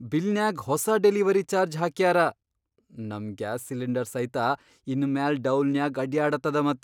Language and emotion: Kannada, surprised